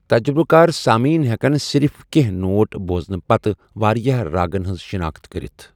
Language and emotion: Kashmiri, neutral